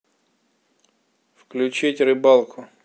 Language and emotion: Russian, neutral